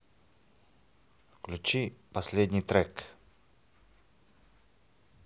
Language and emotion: Russian, neutral